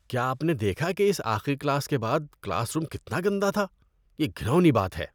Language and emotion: Urdu, disgusted